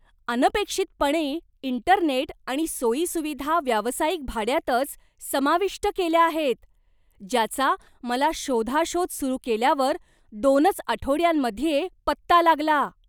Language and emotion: Marathi, surprised